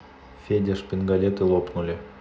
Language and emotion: Russian, neutral